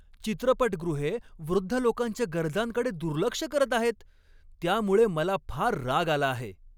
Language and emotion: Marathi, angry